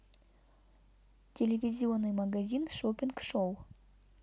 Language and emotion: Russian, neutral